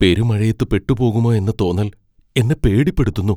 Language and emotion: Malayalam, fearful